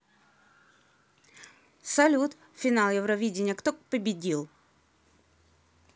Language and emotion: Russian, neutral